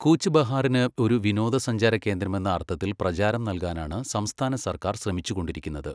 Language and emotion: Malayalam, neutral